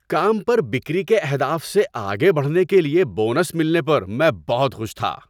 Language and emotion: Urdu, happy